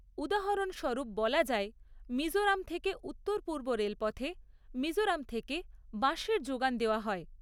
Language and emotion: Bengali, neutral